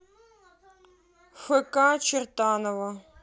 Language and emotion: Russian, neutral